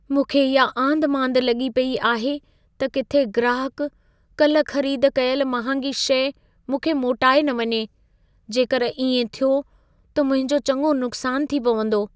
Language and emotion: Sindhi, fearful